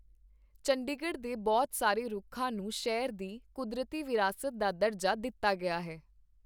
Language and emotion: Punjabi, neutral